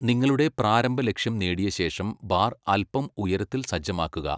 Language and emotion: Malayalam, neutral